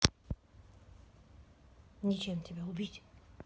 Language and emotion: Russian, angry